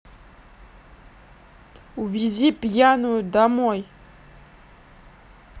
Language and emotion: Russian, neutral